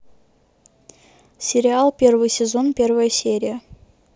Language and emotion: Russian, neutral